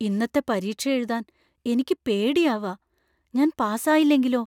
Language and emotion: Malayalam, fearful